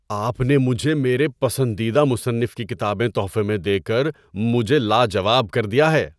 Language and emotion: Urdu, surprised